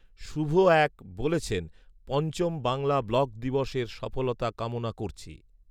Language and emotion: Bengali, neutral